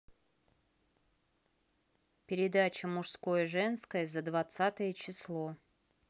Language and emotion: Russian, neutral